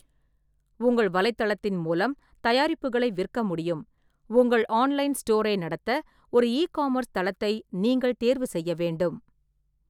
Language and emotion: Tamil, neutral